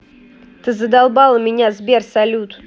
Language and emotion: Russian, angry